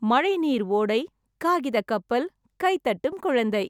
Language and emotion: Tamil, happy